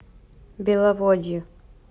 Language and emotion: Russian, neutral